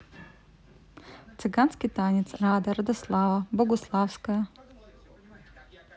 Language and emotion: Russian, neutral